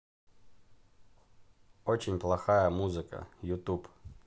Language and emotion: Russian, neutral